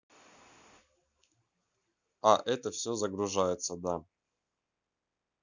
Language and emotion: Russian, neutral